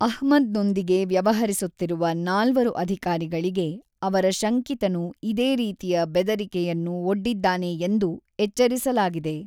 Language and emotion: Kannada, neutral